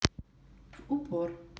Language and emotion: Russian, neutral